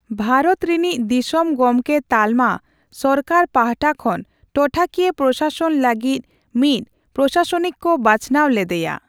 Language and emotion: Santali, neutral